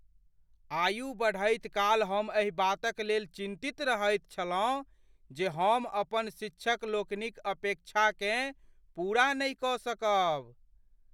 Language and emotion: Maithili, fearful